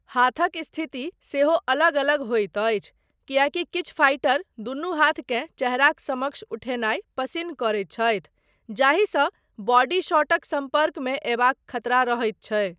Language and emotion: Maithili, neutral